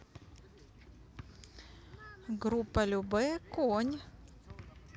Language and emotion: Russian, neutral